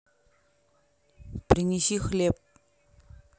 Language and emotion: Russian, neutral